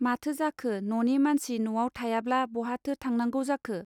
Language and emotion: Bodo, neutral